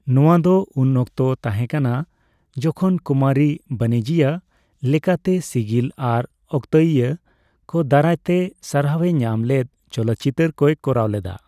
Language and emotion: Santali, neutral